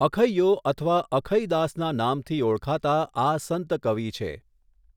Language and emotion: Gujarati, neutral